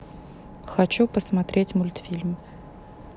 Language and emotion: Russian, neutral